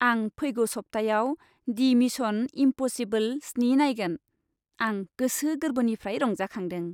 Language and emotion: Bodo, happy